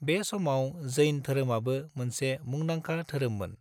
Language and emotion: Bodo, neutral